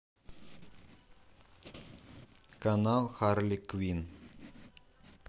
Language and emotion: Russian, neutral